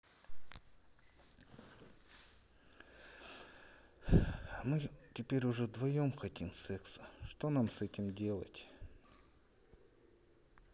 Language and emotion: Russian, sad